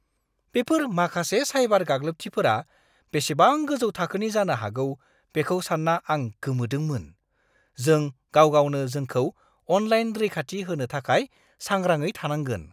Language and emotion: Bodo, surprised